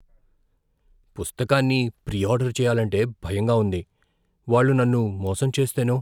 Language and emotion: Telugu, fearful